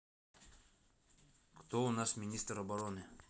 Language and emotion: Russian, neutral